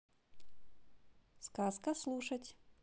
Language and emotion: Russian, positive